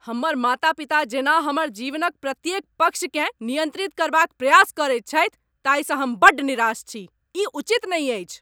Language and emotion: Maithili, angry